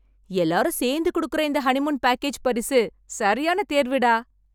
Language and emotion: Tamil, happy